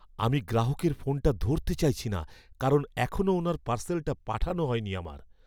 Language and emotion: Bengali, fearful